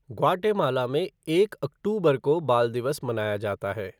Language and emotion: Hindi, neutral